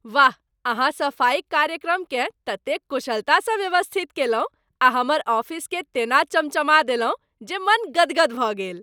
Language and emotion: Maithili, happy